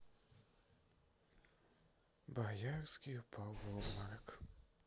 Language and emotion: Russian, sad